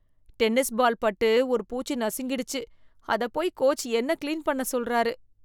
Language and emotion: Tamil, disgusted